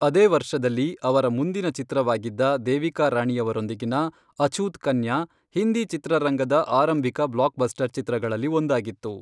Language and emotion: Kannada, neutral